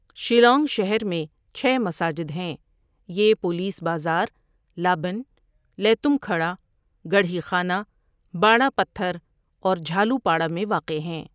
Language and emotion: Urdu, neutral